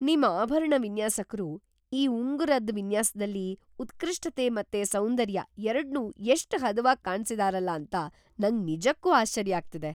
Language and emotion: Kannada, surprised